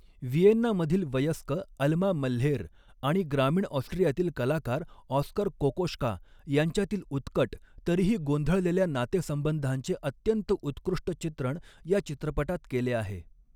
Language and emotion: Marathi, neutral